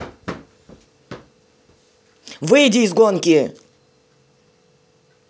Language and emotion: Russian, angry